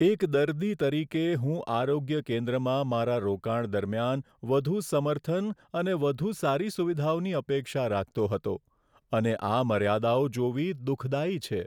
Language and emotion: Gujarati, sad